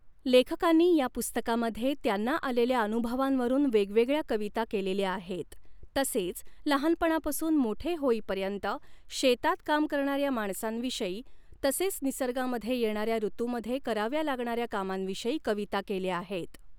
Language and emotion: Marathi, neutral